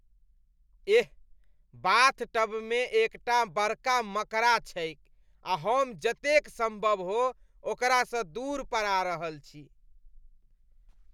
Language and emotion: Maithili, disgusted